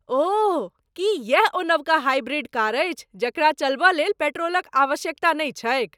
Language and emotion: Maithili, surprised